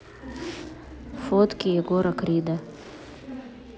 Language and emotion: Russian, neutral